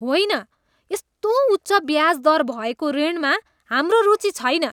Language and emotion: Nepali, disgusted